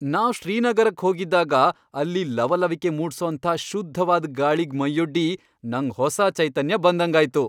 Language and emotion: Kannada, happy